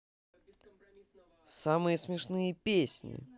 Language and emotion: Russian, positive